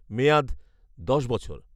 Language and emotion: Bengali, neutral